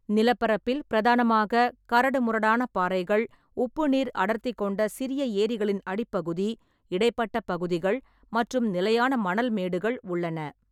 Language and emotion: Tamil, neutral